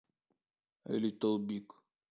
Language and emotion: Russian, neutral